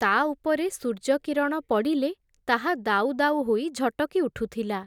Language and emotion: Odia, neutral